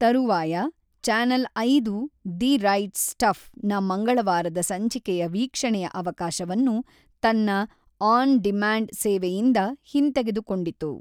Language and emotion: Kannada, neutral